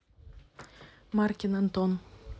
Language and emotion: Russian, neutral